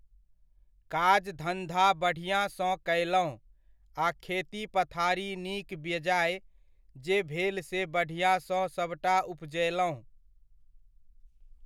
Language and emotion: Maithili, neutral